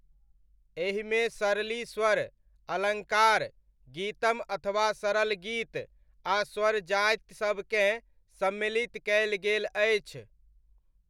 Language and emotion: Maithili, neutral